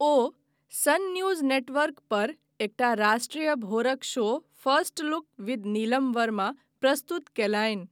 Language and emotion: Maithili, neutral